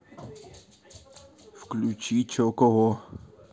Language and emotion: Russian, neutral